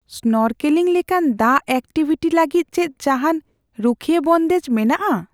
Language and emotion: Santali, fearful